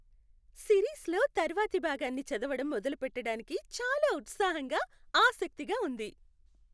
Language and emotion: Telugu, happy